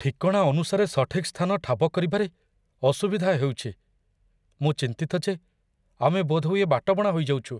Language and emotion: Odia, fearful